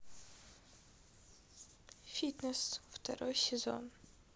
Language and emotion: Russian, neutral